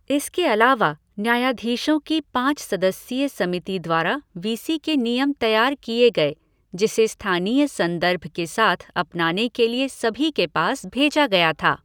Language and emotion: Hindi, neutral